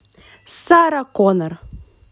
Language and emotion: Russian, positive